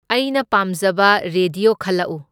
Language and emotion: Manipuri, neutral